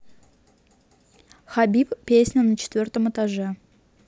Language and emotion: Russian, neutral